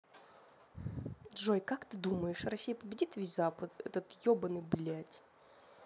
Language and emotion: Russian, angry